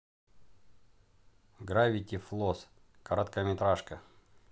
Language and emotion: Russian, neutral